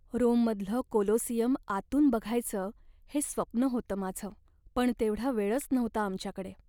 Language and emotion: Marathi, sad